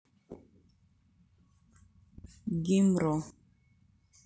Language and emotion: Russian, neutral